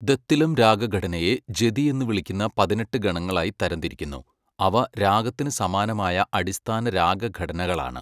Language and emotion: Malayalam, neutral